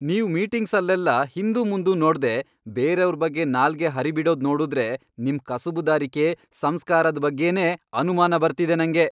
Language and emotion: Kannada, angry